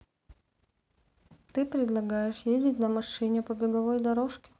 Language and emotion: Russian, neutral